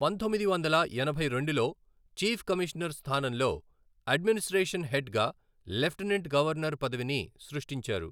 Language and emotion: Telugu, neutral